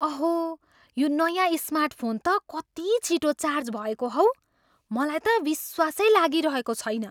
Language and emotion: Nepali, surprised